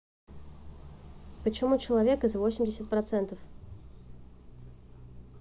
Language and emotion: Russian, neutral